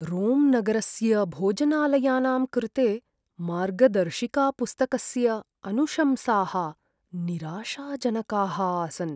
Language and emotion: Sanskrit, sad